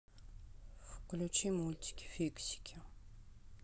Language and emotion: Russian, neutral